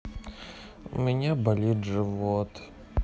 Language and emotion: Russian, sad